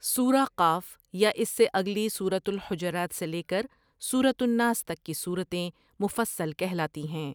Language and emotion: Urdu, neutral